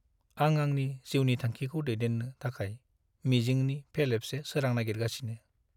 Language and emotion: Bodo, sad